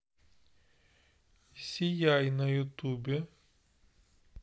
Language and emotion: Russian, neutral